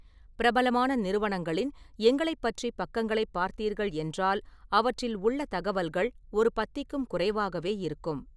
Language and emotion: Tamil, neutral